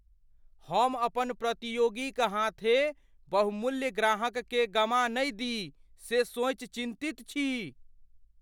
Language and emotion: Maithili, fearful